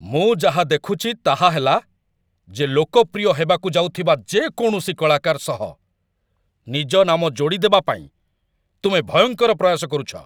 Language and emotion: Odia, angry